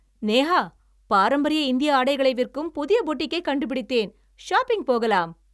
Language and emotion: Tamil, happy